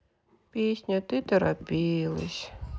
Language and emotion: Russian, sad